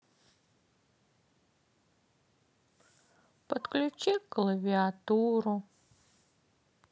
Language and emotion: Russian, sad